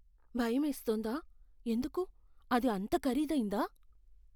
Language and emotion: Telugu, fearful